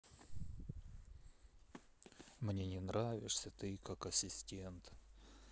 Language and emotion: Russian, sad